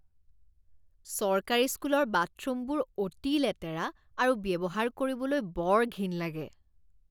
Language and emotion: Assamese, disgusted